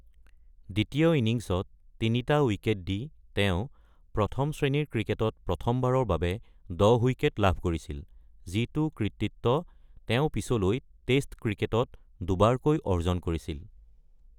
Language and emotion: Assamese, neutral